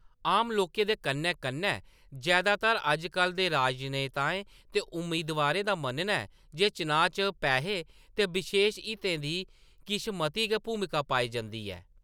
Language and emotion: Dogri, neutral